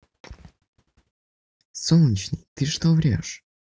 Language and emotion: Russian, neutral